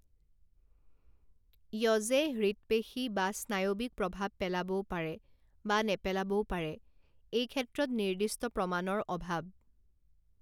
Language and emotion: Assamese, neutral